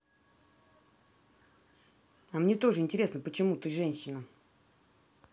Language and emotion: Russian, neutral